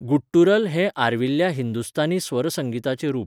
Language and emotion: Goan Konkani, neutral